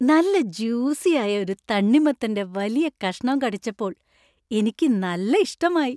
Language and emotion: Malayalam, happy